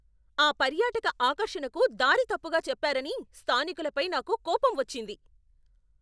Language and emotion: Telugu, angry